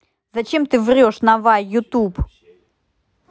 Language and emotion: Russian, angry